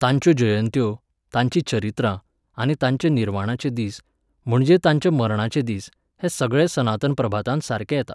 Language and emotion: Goan Konkani, neutral